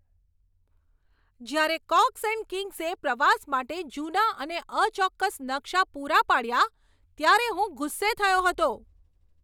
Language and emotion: Gujarati, angry